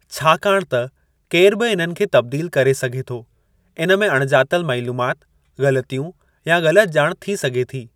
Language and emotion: Sindhi, neutral